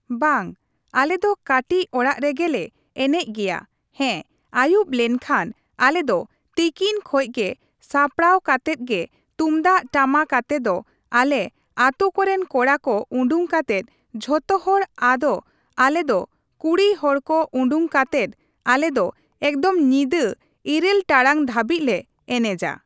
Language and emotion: Santali, neutral